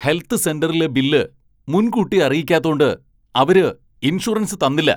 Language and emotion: Malayalam, angry